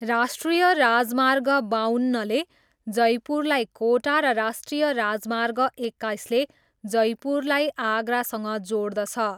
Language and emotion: Nepali, neutral